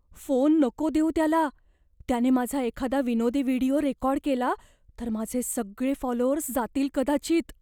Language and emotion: Marathi, fearful